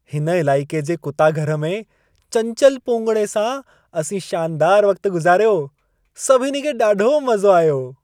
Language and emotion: Sindhi, happy